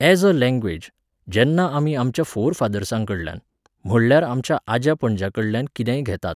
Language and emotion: Goan Konkani, neutral